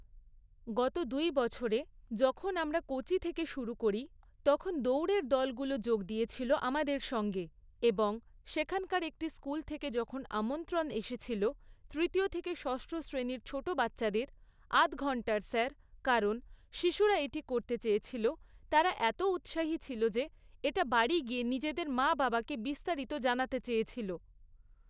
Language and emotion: Bengali, neutral